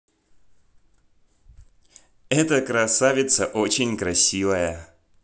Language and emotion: Russian, positive